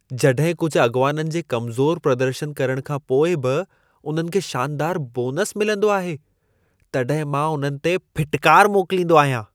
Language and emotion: Sindhi, disgusted